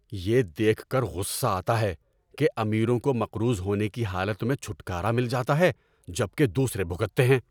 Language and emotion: Urdu, angry